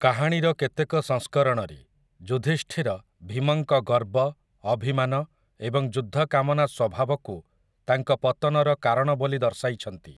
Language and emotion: Odia, neutral